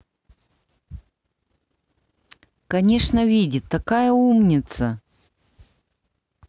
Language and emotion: Russian, positive